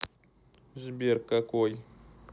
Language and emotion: Russian, neutral